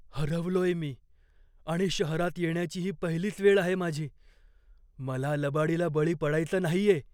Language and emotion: Marathi, fearful